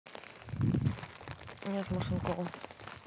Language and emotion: Russian, neutral